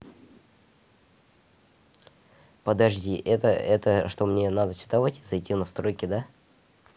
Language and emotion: Russian, neutral